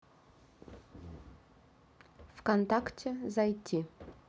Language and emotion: Russian, neutral